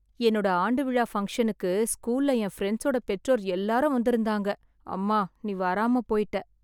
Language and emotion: Tamil, sad